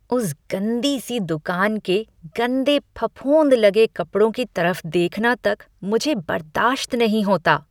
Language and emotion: Hindi, disgusted